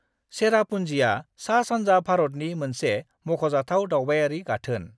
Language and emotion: Bodo, neutral